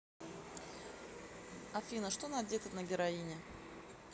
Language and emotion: Russian, neutral